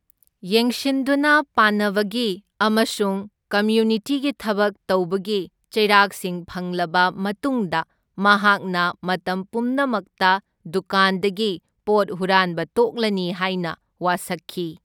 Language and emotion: Manipuri, neutral